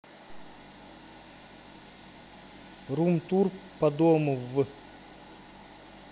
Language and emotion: Russian, neutral